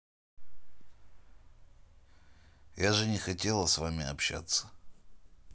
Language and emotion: Russian, neutral